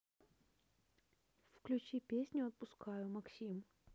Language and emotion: Russian, neutral